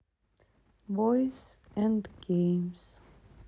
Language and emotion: Russian, sad